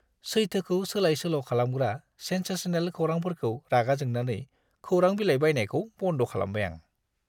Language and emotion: Bodo, disgusted